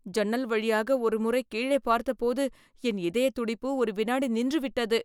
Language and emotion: Tamil, fearful